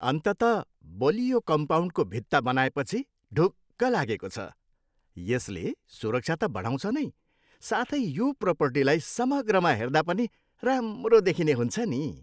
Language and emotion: Nepali, happy